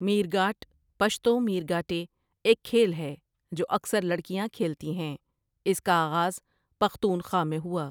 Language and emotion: Urdu, neutral